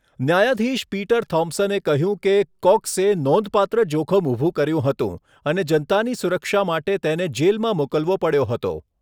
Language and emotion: Gujarati, neutral